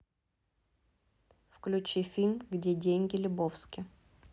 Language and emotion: Russian, neutral